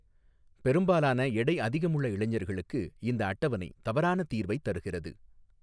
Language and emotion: Tamil, neutral